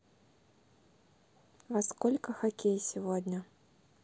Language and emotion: Russian, neutral